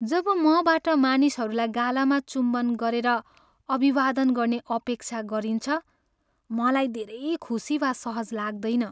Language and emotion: Nepali, sad